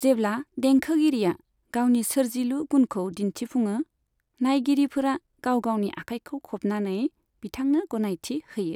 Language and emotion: Bodo, neutral